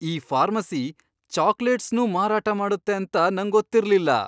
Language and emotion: Kannada, surprised